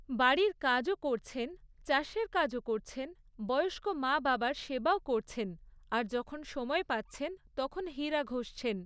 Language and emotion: Bengali, neutral